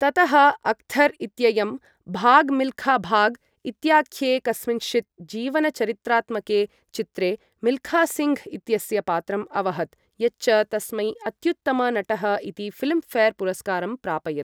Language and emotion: Sanskrit, neutral